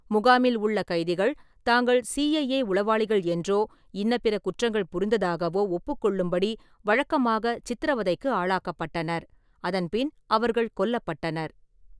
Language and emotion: Tamil, neutral